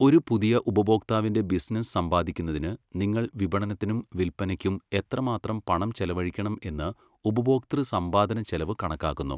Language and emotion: Malayalam, neutral